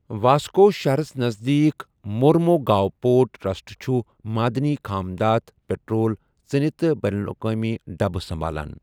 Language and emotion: Kashmiri, neutral